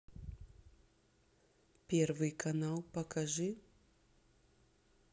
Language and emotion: Russian, neutral